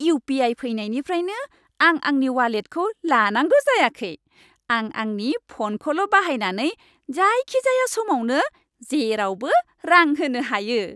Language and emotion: Bodo, happy